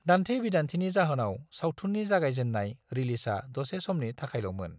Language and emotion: Bodo, neutral